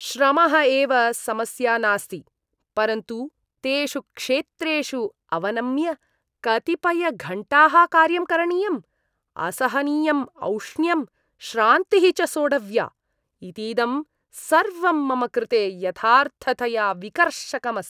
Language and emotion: Sanskrit, disgusted